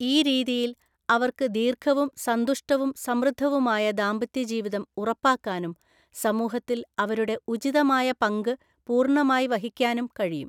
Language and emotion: Malayalam, neutral